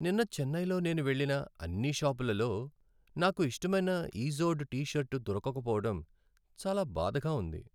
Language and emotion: Telugu, sad